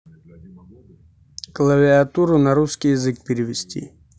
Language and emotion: Russian, neutral